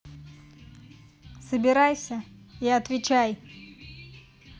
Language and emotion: Russian, angry